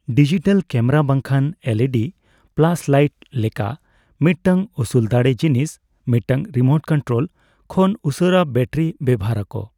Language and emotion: Santali, neutral